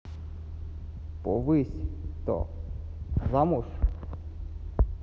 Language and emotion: Russian, neutral